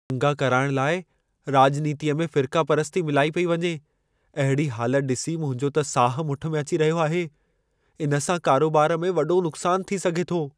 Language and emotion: Sindhi, fearful